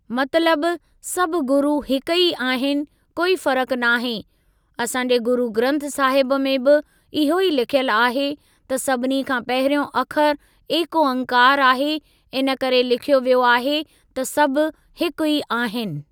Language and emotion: Sindhi, neutral